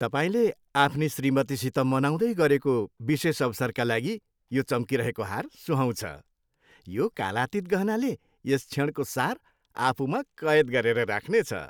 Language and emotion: Nepali, happy